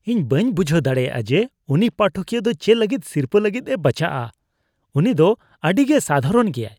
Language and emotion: Santali, disgusted